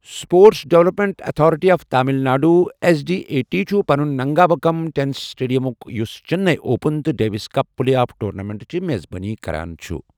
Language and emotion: Kashmiri, neutral